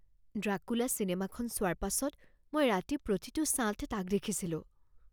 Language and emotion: Assamese, fearful